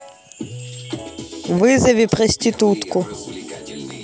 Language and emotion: Russian, neutral